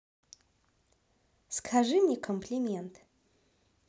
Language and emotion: Russian, positive